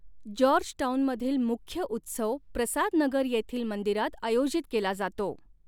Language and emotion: Marathi, neutral